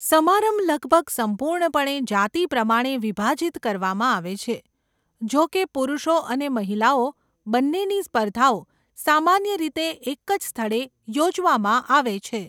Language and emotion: Gujarati, neutral